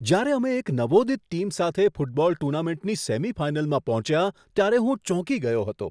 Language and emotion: Gujarati, surprised